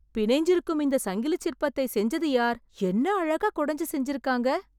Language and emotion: Tamil, surprised